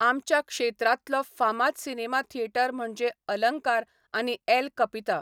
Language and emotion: Goan Konkani, neutral